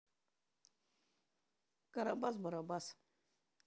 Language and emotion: Russian, neutral